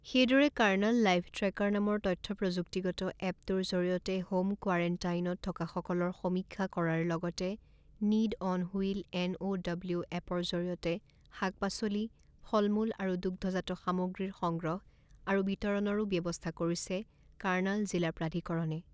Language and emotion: Assamese, neutral